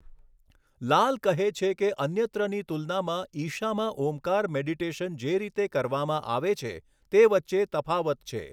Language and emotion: Gujarati, neutral